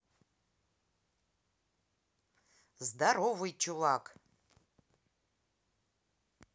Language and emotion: Russian, neutral